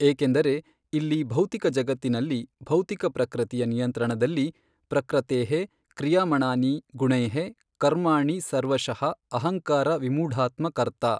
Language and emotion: Kannada, neutral